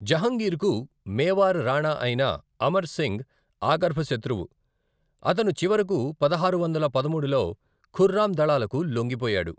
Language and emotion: Telugu, neutral